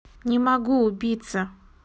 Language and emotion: Russian, neutral